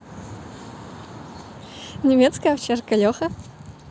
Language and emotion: Russian, positive